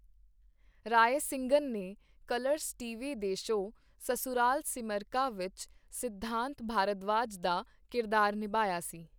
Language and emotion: Punjabi, neutral